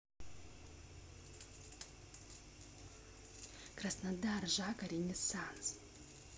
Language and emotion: Russian, neutral